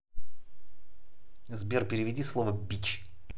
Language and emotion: Russian, angry